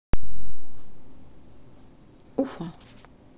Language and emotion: Russian, neutral